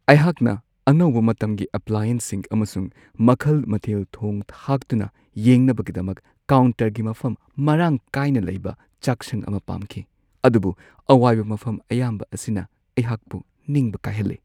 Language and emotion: Manipuri, sad